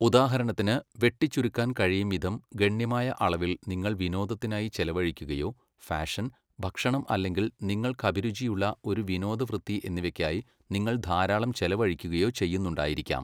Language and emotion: Malayalam, neutral